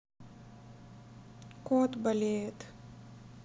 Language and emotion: Russian, sad